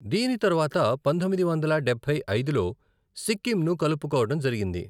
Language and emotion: Telugu, neutral